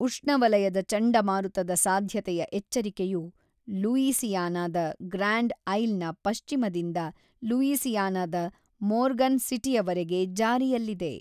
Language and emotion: Kannada, neutral